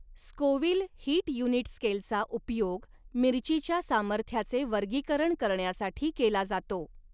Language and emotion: Marathi, neutral